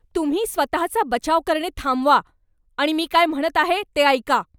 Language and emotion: Marathi, angry